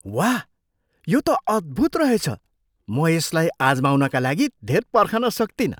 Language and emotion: Nepali, surprised